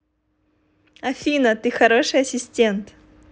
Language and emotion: Russian, positive